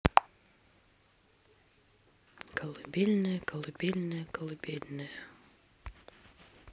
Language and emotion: Russian, sad